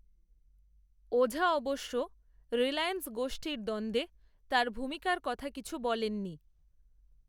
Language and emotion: Bengali, neutral